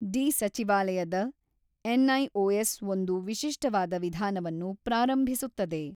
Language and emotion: Kannada, neutral